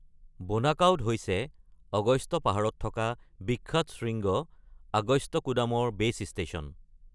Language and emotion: Assamese, neutral